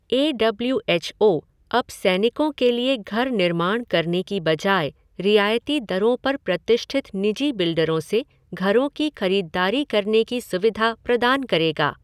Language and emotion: Hindi, neutral